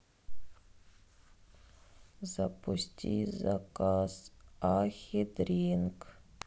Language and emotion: Russian, sad